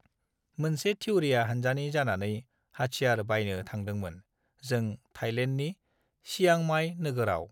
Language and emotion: Bodo, neutral